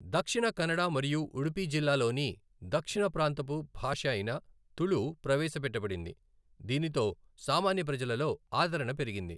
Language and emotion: Telugu, neutral